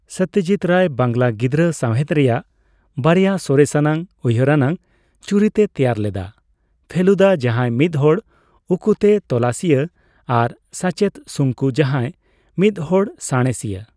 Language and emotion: Santali, neutral